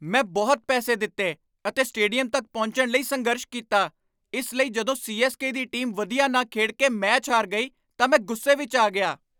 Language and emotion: Punjabi, angry